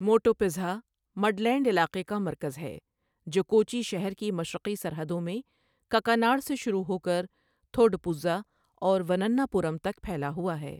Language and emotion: Urdu, neutral